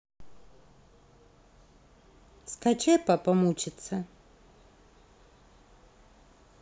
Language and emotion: Russian, neutral